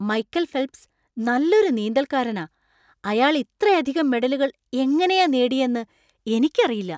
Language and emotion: Malayalam, surprised